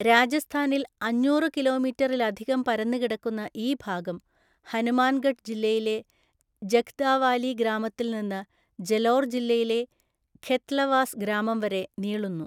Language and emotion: Malayalam, neutral